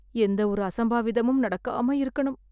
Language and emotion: Tamil, fearful